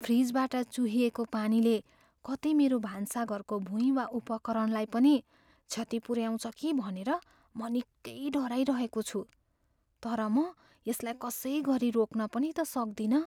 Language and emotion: Nepali, fearful